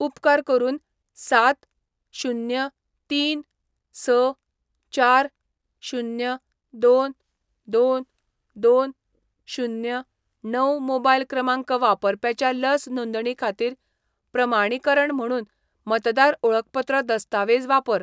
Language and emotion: Goan Konkani, neutral